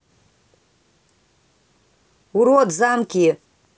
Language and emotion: Russian, angry